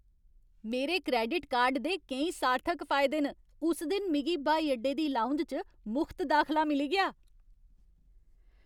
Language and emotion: Dogri, happy